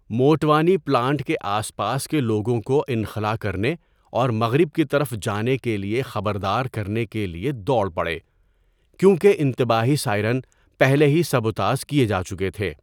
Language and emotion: Urdu, neutral